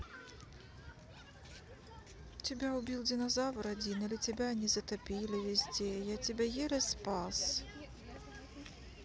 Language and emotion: Russian, sad